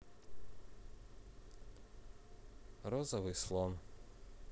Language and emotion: Russian, neutral